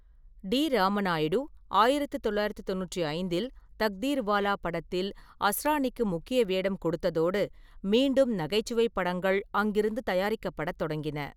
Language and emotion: Tamil, neutral